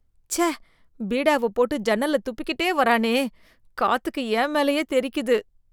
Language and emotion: Tamil, disgusted